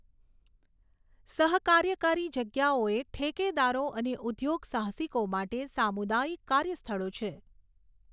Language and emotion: Gujarati, neutral